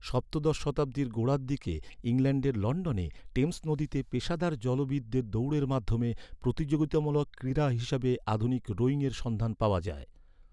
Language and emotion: Bengali, neutral